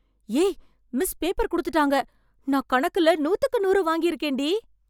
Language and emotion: Tamil, surprised